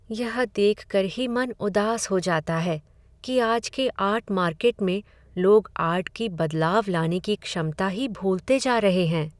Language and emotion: Hindi, sad